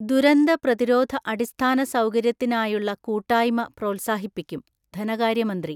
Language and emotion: Malayalam, neutral